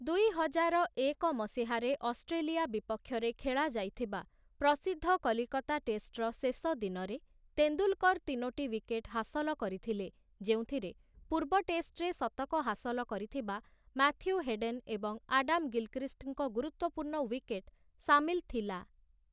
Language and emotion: Odia, neutral